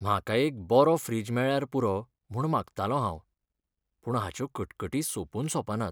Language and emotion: Goan Konkani, sad